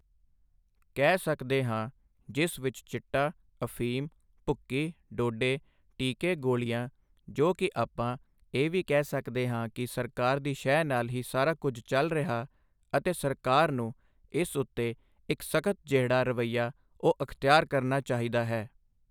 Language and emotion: Punjabi, neutral